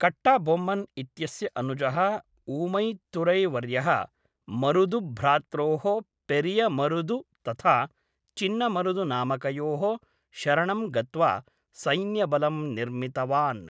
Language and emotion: Sanskrit, neutral